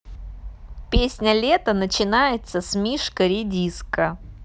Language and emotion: Russian, neutral